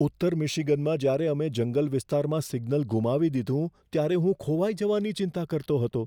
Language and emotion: Gujarati, fearful